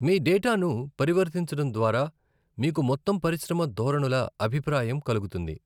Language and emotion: Telugu, neutral